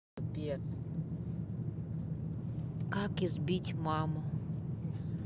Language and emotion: Russian, neutral